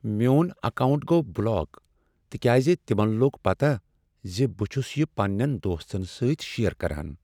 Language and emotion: Kashmiri, sad